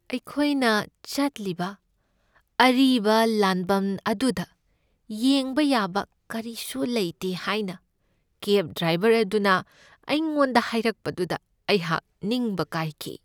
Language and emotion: Manipuri, sad